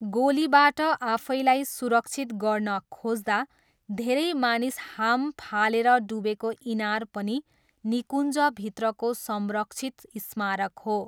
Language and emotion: Nepali, neutral